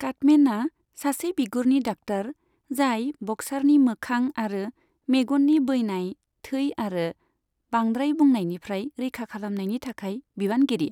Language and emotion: Bodo, neutral